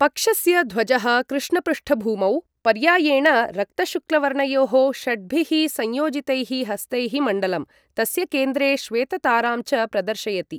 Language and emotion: Sanskrit, neutral